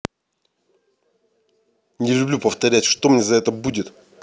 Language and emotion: Russian, angry